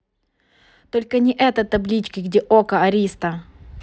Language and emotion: Russian, neutral